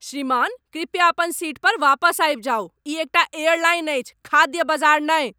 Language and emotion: Maithili, angry